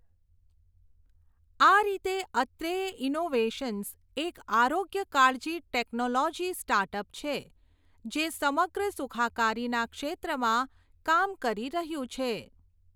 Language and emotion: Gujarati, neutral